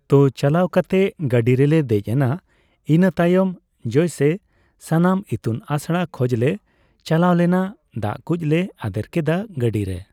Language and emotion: Santali, neutral